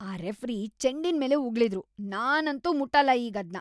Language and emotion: Kannada, disgusted